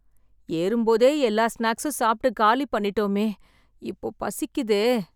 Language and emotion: Tamil, sad